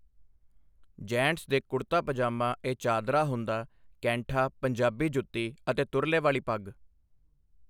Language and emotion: Punjabi, neutral